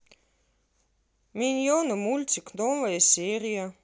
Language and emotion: Russian, neutral